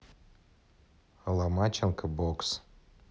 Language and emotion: Russian, neutral